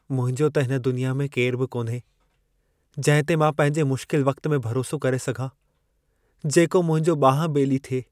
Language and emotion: Sindhi, sad